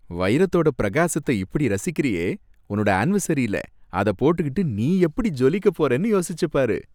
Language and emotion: Tamil, happy